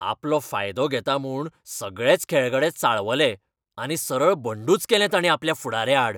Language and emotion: Goan Konkani, angry